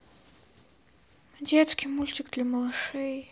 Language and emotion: Russian, sad